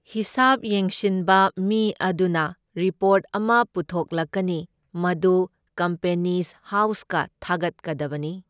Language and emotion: Manipuri, neutral